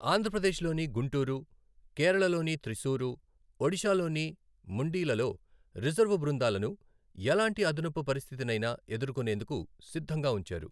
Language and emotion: Telugu, neutral